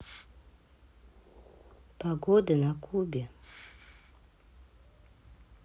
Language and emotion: Russian, neutral